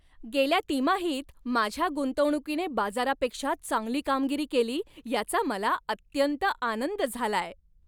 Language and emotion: Marathi, happy